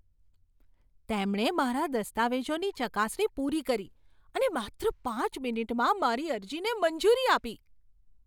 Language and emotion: Gujarati, surprised